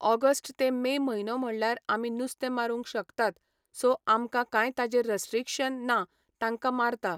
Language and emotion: Goan Konkani, neutral